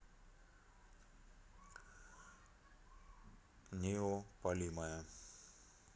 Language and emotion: Russian, neutral